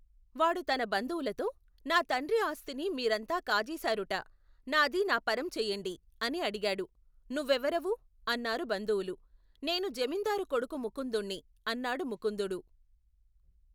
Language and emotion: Telugu, neutral